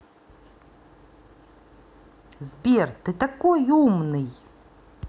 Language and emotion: Russian, positive